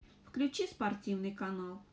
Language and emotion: Russian, neutral